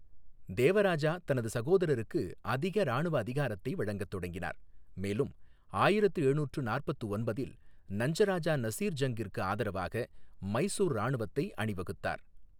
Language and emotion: Tamil, neutral